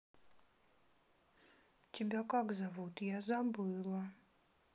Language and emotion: Russian, sad